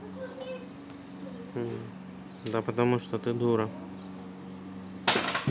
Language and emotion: Russian, neutral